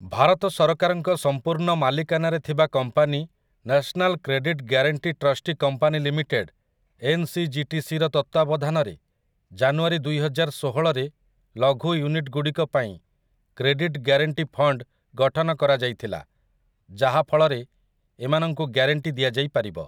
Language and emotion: Odia, neutral